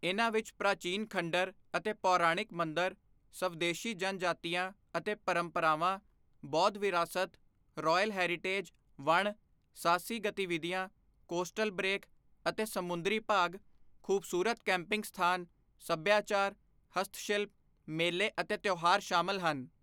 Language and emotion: Punjabi, neutral